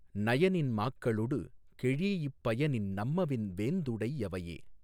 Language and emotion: Tamil, neutral